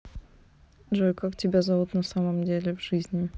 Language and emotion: Russian, neutral